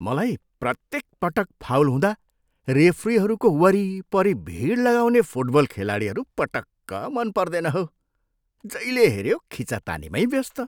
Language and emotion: Nepali, disgusted